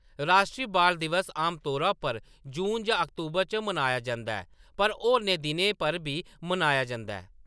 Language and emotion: Dogri, neutral